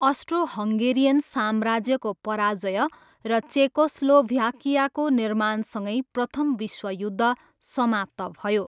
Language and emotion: Nepali, neutral